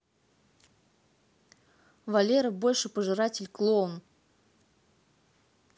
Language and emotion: Russian, neutral